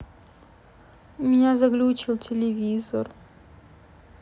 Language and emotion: Russian, sad